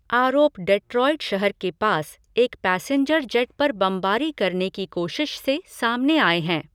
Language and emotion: Hindi, neutral